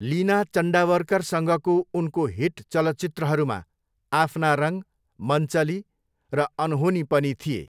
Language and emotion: Nepali, neutral